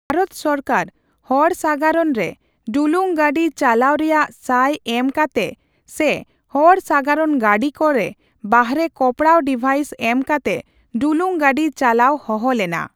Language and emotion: Santali, neutral